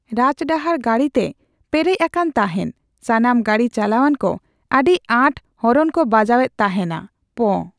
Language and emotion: Santali, neutral